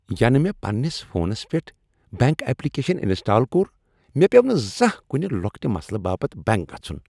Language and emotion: Kashmiri, happy